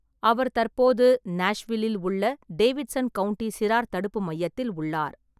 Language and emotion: Tamil, neutral